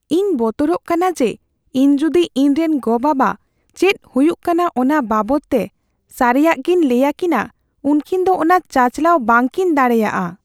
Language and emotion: Santali, fearful